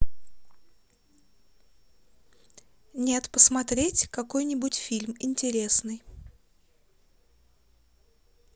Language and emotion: Russian, neutral